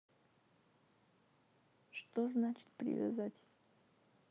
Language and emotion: Russian, sad